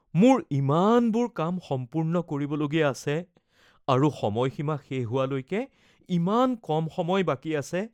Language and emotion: Assamese, fearful